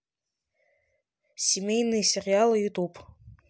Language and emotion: Russian, neutral